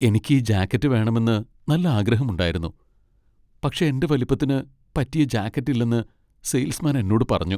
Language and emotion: Malayalam, sad